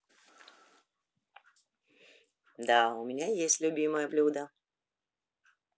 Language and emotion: Russian, positive